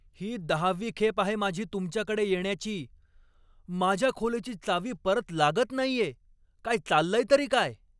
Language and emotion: Marathi, angry